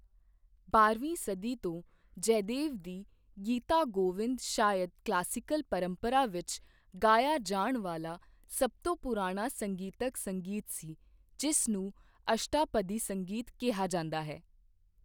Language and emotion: Punjabi, neutral